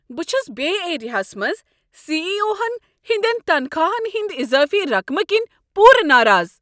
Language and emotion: Kashmiri, angry